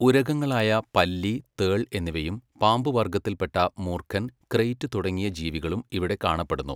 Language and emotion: Malayalam, neutral